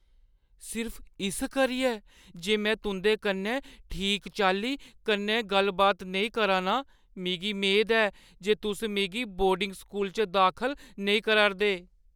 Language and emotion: Dogri, fearful